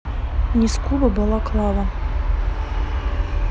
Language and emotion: Russian, neutral